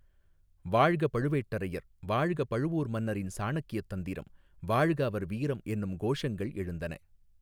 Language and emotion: Tamil, neutral